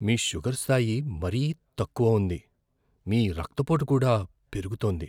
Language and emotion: Telugu, fearful